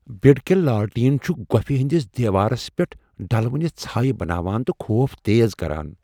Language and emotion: Kashmiri, fearful